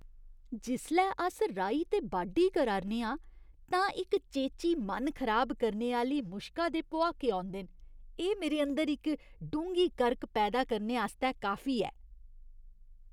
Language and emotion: Dogri, disgusted